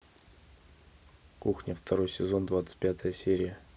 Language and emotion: Russian, neutral